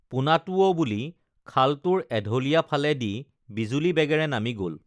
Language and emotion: Assamese, neutral